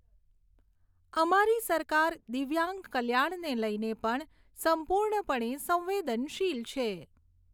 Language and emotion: Gujarati, neutral